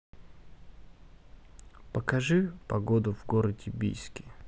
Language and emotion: Russian, neutral